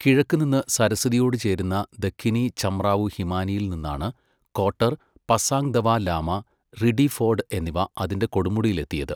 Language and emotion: Malayalam, neutral